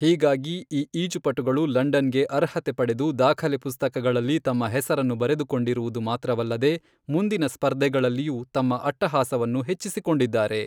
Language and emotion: Kannada, neutral